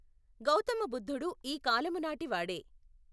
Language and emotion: Telugu, neutral